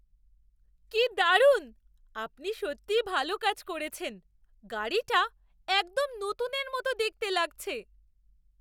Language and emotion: Bengali, surprised